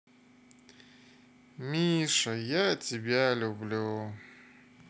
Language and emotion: Russian, sad